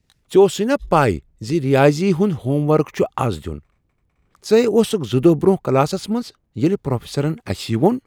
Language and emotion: Kashmiri, surprised